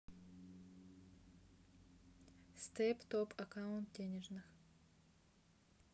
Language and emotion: Russian, neutral